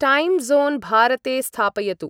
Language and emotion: Sanskrit, neutral